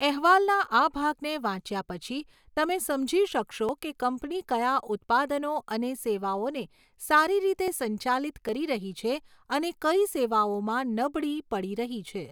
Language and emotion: Gujarati, neutral